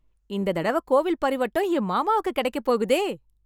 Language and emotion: Tamil, happy